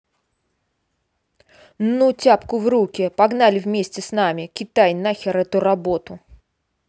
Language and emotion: Russian, angry